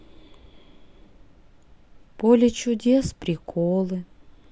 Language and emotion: Russian, sad